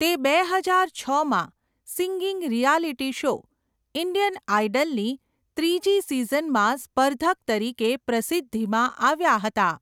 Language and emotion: Gujarati, neutral